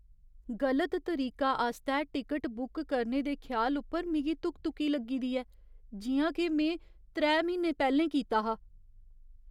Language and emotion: Dogri, fearful